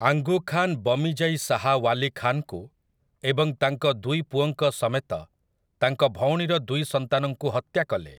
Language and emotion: Odia, neutral